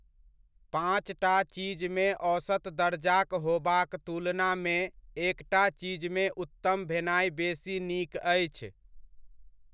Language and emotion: Maithili, neutral